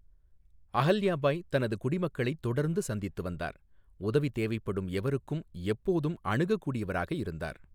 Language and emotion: Tamil, neutral